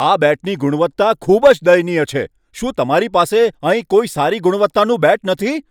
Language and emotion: Gujarati, angry